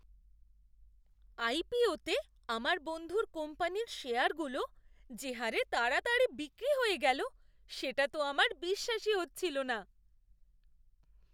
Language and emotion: Bengali, surprised